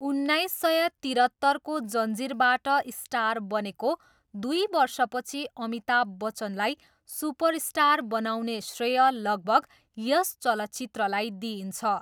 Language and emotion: Nepali, neutral